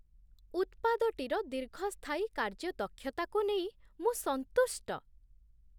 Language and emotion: Odia, surprised